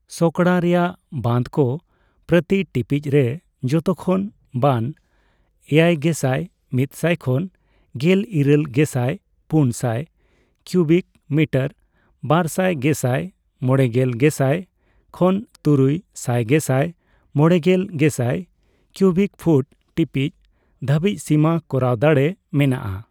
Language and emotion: Santali, neutral